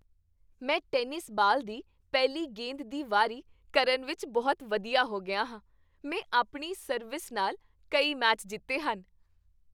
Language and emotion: Punjabi, happy